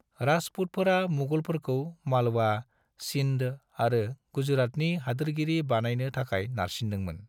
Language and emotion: Bodo, neutral